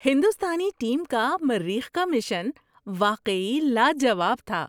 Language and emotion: Urdu, surprised